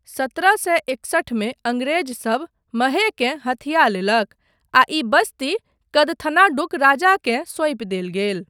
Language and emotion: Maithili, neutral